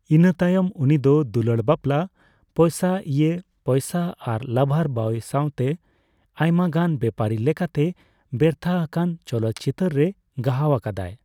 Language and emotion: Santali, neutral